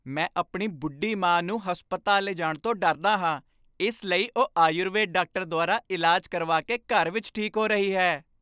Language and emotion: Punjabi, happy